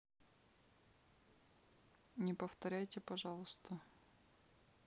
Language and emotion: Russian, neutral